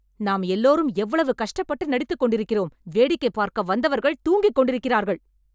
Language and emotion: Tamil, angry